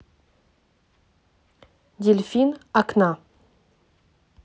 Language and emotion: Russian, neutral